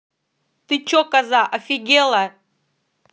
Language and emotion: Russian, angry